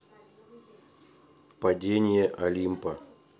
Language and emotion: Russian, neutral